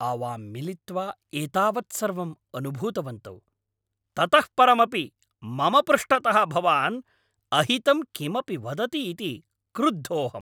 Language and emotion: Sanskrit, angry